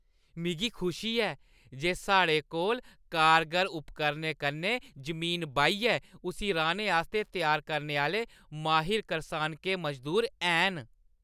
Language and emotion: Dogri, happy